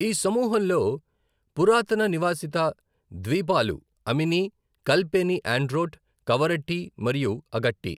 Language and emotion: Telugu, neutral